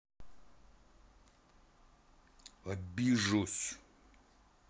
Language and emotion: Russian, neutral